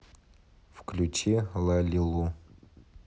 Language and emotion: Russian, neutral